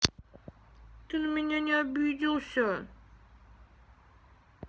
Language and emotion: Russian, sad